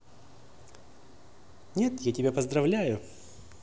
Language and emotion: Russian, positive